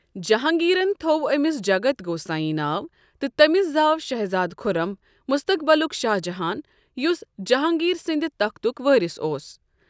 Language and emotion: Kashmiri, neutral